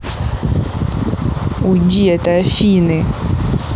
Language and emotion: Russian, angry